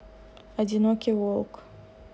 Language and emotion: Russian, sad